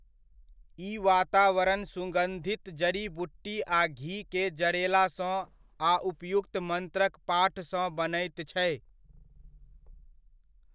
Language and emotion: Maithili, neutral